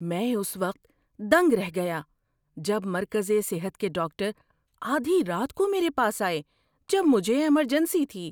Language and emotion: Urdu, surprised